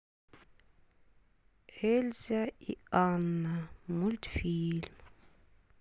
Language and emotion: Russian, sad